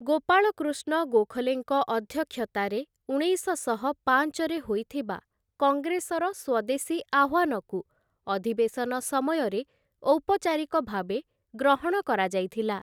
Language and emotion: Odia, neutral